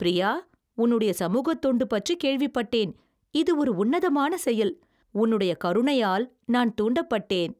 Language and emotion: Tamil, happy